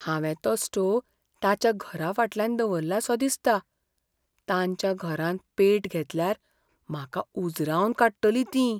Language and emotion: Goan Konkani, fearful